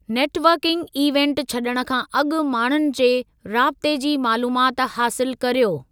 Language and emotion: Sindhi, neutral